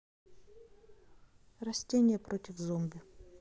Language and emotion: Russian, neutral